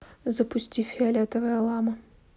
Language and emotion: Russian, neutral